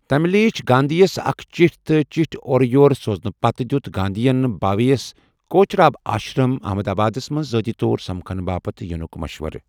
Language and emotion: Kashmiri, neutral